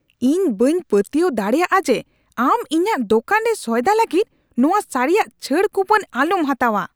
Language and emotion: Santali, angry